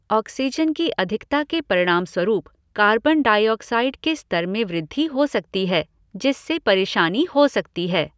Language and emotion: Hindi, neutral